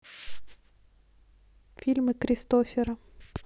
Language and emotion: Russian, neutral